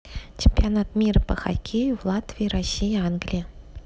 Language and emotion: Russian, neutral